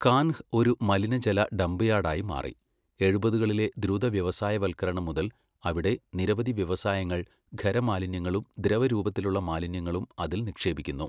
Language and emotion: Malayalam, neutral